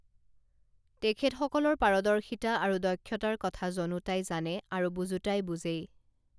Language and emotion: Assamese, neutral